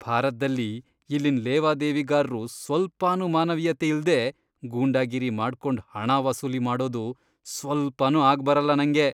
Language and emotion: Kannada, disgusted